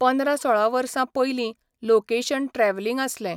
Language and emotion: Goan Konkani, neutral